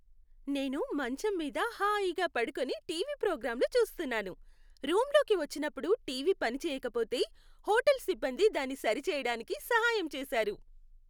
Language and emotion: Telugu, happy